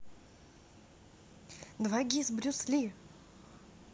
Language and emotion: Russian, positive